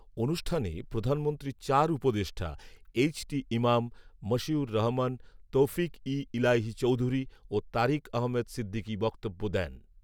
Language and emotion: Bengali, neutral